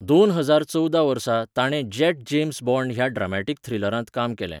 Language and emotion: Goan Konkani, neutral